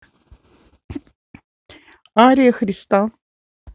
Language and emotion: Russian, neutral